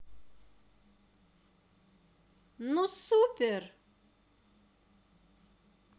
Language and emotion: Russian, positive